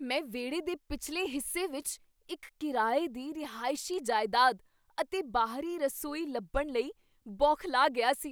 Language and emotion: Punjabi, surprised